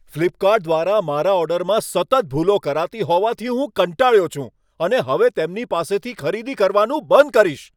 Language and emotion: Gujarati, angry